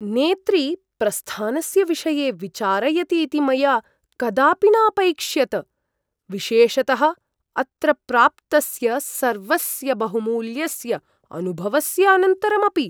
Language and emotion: Sanskrit, surprised